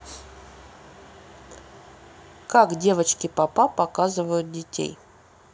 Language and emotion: Russian, neutral